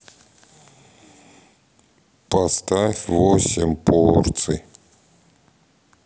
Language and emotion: Russian, sad